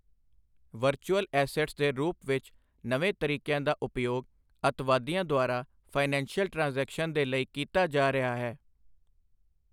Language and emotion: Punjabi, neutral